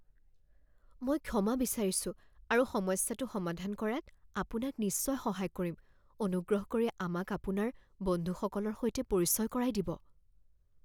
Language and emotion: Assamese, fearful